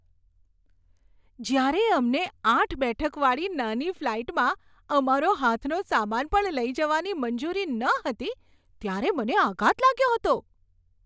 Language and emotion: Gujarati, surprised